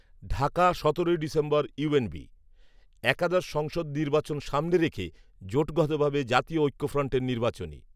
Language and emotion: Bengali, neutral